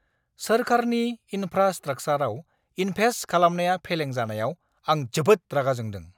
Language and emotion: Bodo, angry